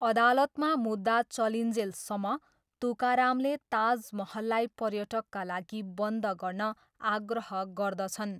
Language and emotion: Nepali, neutral